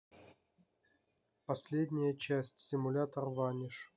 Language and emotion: Russian, neutral